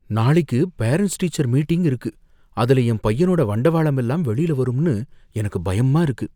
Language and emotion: Tamil, fearful